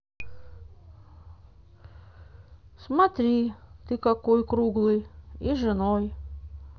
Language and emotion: Russian, neutral